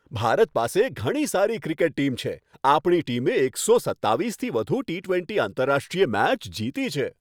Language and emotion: Gujarati, happy